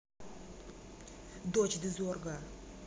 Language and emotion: Russian, angry